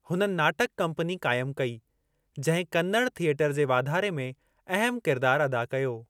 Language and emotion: Sindhi, neutral